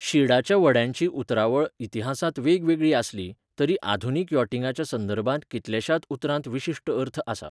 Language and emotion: Goan Konkani, neutral